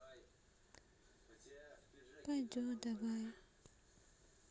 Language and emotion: Russian, sad